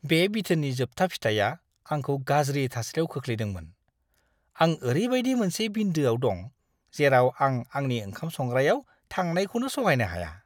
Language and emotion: Bodo, disgusted